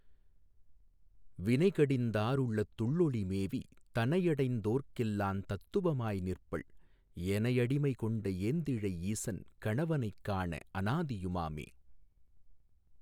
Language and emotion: Tamil, neutral